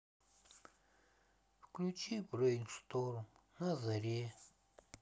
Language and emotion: Russian, sad